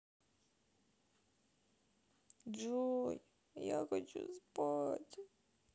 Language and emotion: Russian, sad